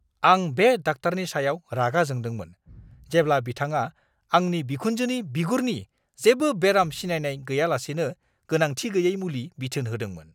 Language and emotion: Bodo, angry